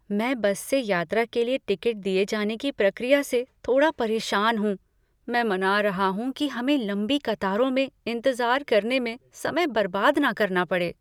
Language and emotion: Hindi, fearful